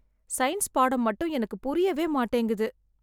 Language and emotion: Tamil, sad